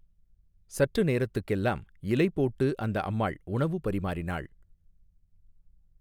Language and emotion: Tamil, neutral